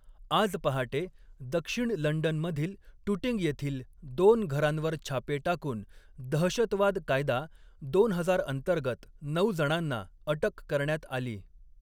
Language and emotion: Marathi, neutral